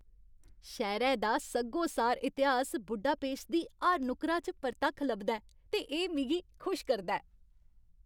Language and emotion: Dogri, happy